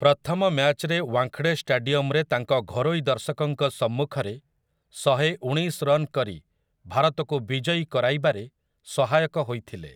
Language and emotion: Odia, neutral